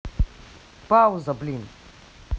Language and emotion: Russian, angry